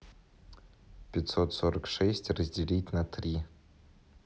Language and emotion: Russian, neutral